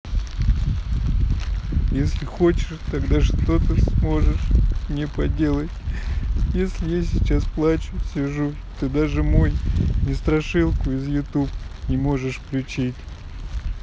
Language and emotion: Russian, sad